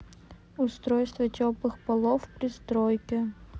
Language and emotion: Russian, neutral